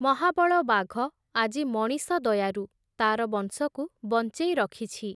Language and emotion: Odia, neutral